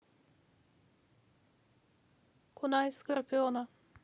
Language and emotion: Russian, neutral